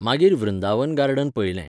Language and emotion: Goan Konkani, neutral